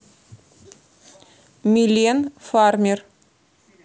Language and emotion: Russian, neutral